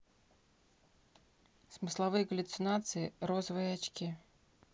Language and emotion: Russian, neutral